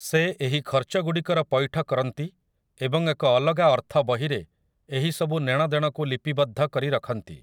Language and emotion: Odia, neutral